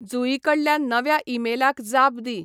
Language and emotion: Goan Konkani, neutral